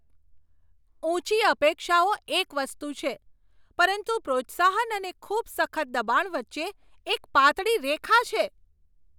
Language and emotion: Gujarati, angry